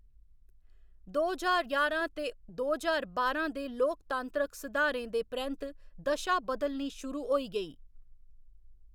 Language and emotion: Dogri, neutral